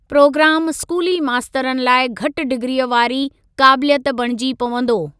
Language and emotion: Sindhi, neutral